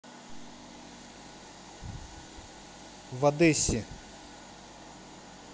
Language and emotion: Russian, neutral